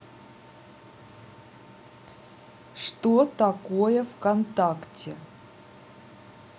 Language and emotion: Russian, neutral